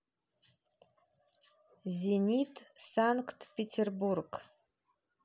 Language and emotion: Russian, neutral